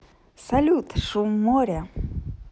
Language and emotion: Russian, positive